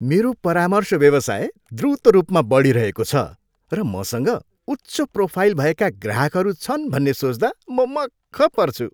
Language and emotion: Nepali, happy